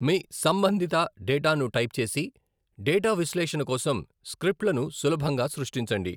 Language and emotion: Telugu, neutral